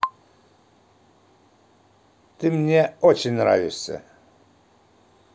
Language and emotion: Russian, positive